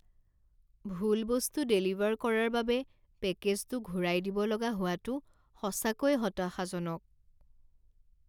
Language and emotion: Assamese, sad